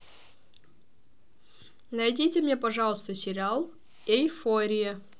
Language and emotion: Russian, neutral